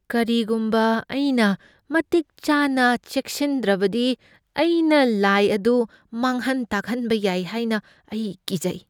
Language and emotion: Manipuri, fearful